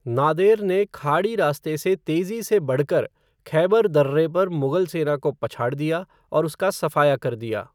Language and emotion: Hindi, neutral